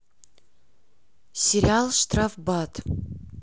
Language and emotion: Russian, neutral